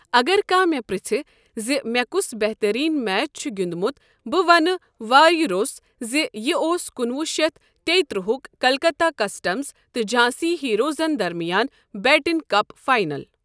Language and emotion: Kashmiri, neutral